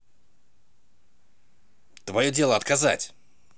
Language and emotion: Russian, angry